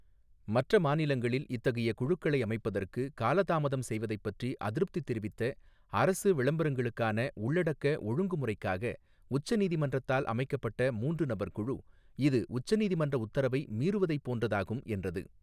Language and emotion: Tamil, neutral